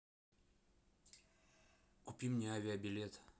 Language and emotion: Russian, neutral